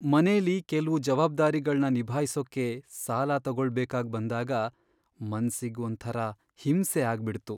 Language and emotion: Kannada, sad